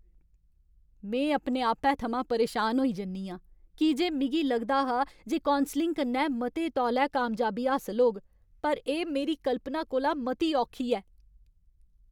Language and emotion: Dogri, angry